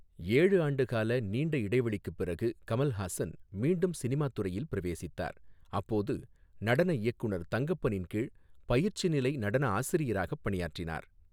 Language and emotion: Tamil, neutral